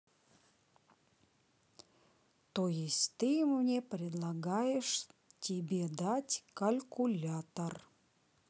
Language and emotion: Russian, neutral